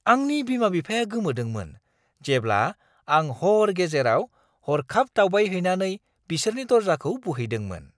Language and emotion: Bodo, surprised